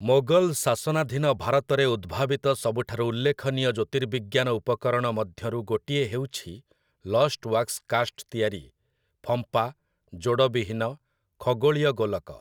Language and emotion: Odia, neutral